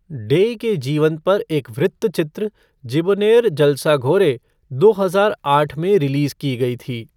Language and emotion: Hindi, neutral